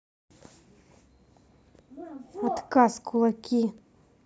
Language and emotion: Russian, neutral